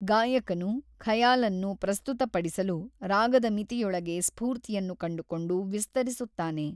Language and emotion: Kannada, neutral